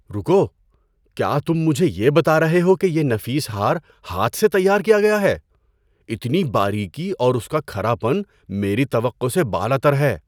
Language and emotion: Urdu, surprised